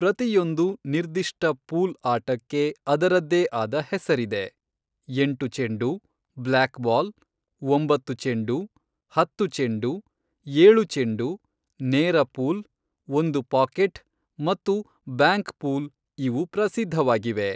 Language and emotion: Kannada, neutral